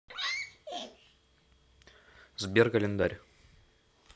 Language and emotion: Russian, neutral